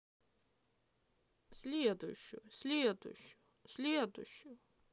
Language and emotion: Russian, neutral